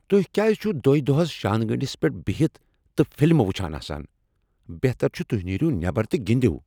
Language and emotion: Kashmiri, angry